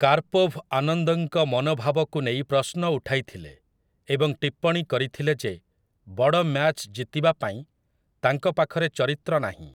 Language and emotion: Odia, neutral